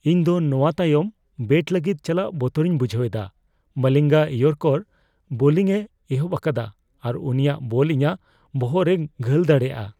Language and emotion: Santali, fearful